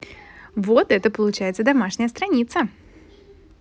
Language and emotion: Russian, positive